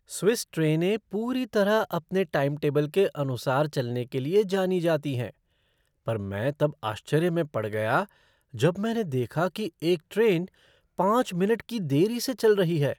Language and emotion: Hindi, surprised